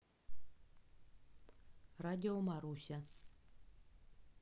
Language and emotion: Russian, neutral